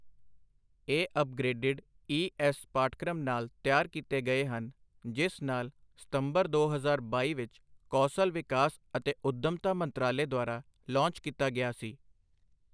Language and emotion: Punjabi, neutral